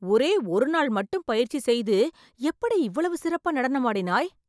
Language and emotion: Tamil, surprised